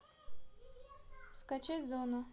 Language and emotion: Russian, neutral